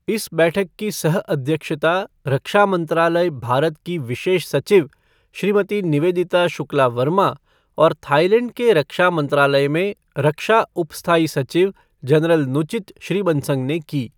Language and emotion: Hindi, neutral